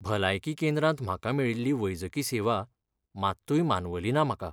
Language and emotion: Goan Konkani, sad